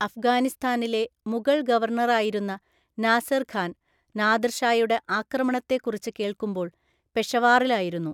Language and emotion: Malayalam, neutral